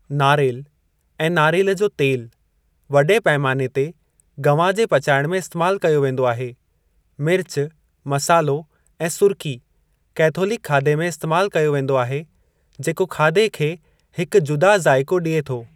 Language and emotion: Sindhi, neutral